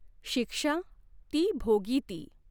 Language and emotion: Marathi, neutral